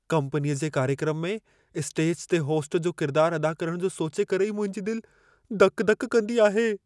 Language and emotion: Sindhi, fearful